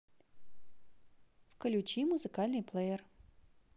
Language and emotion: Russian, positive